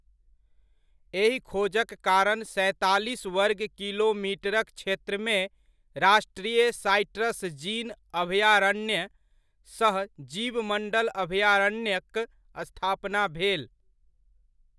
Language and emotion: Maithili, neutral